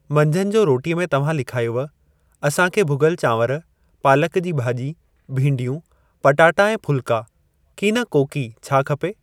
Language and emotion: Sindhi, neutral